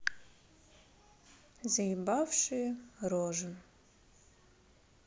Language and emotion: Russian, neutral